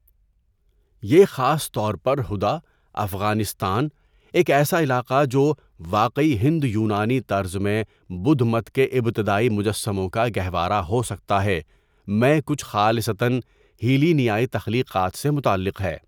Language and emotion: Urdu, neutral